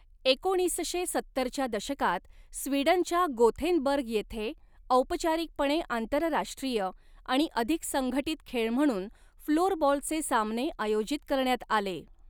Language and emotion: Marathi, neutral